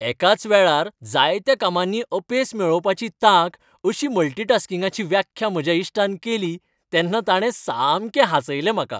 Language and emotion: Goan Konkani, happy